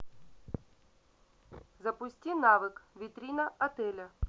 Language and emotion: Russian, neutral